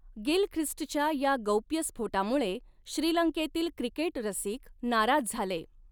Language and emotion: Marathi, neutral